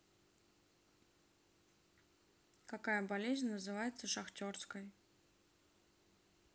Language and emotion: Russian, neutral